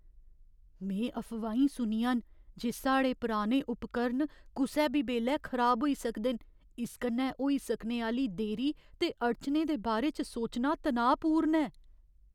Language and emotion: Dogri, fearful